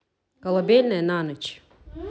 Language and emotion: Russian, neutral